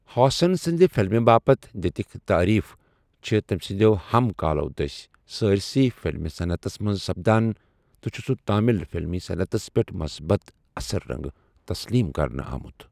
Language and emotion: Kashmiri, neutral